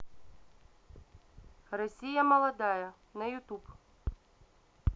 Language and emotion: Russian, neutral